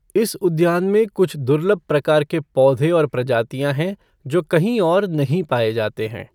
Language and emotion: Hindi, neutral